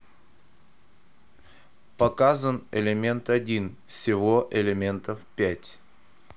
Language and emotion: Russian, neutral